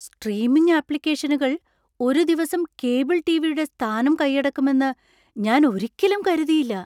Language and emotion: Malayalam, surprised